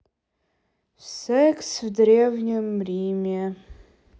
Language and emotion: Russian, sad